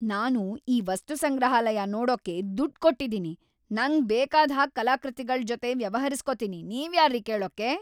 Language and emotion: Kannada, angry